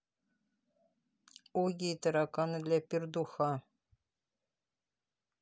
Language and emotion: Russian, neutral